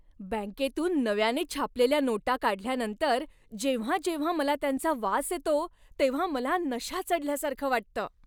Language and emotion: Marathi, happy